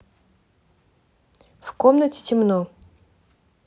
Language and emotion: Russian, neutral